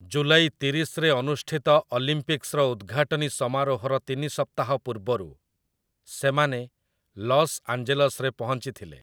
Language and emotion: Odia, neutral